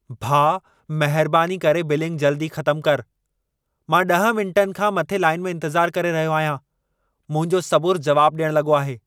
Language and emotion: Sindhi, angry